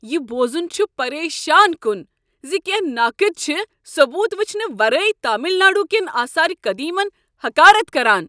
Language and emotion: Kashmiri, angry